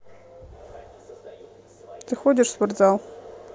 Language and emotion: Russian, neutral